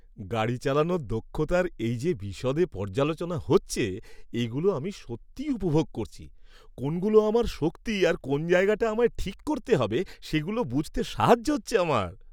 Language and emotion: Bengali, happy